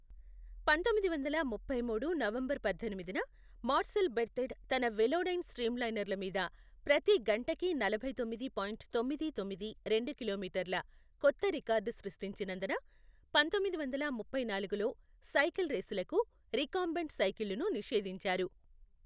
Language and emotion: Telugu, neutral